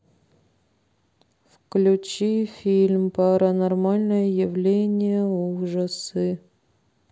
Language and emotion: Russian, sad